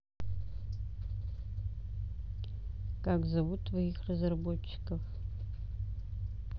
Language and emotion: Russian, neutral